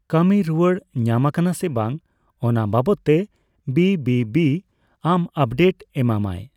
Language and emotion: Santali, neutral